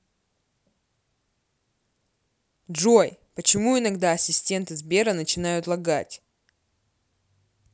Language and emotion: Russian, angry